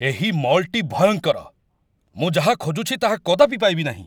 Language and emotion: Odia, angry